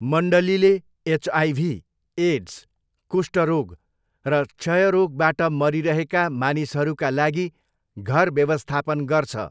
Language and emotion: Nepali, neutral